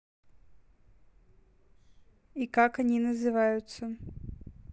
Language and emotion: Russian, neutral